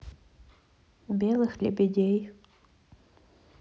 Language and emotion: Russian, neutral